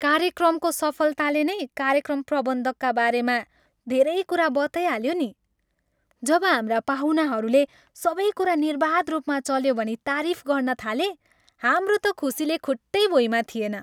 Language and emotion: Nepali, happy